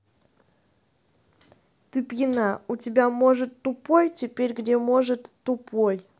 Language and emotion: Russian, angry